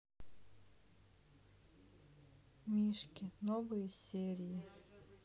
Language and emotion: Russian, sad